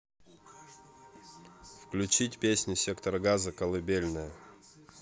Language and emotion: Russian, neutral